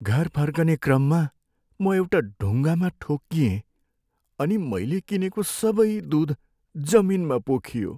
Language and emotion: Nepali, sad